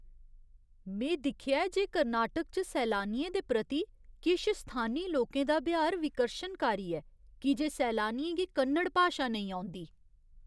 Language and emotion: Dogri, disgusted